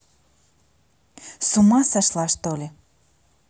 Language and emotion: Russian, angry